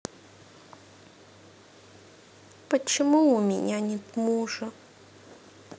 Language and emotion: Russian, sad